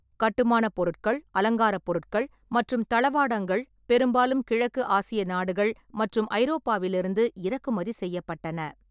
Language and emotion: Tamil, neutral